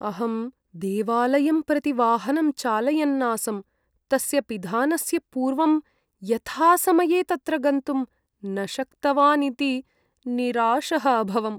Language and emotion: Sanskrit, sad